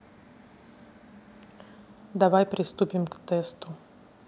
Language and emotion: Russian, neutral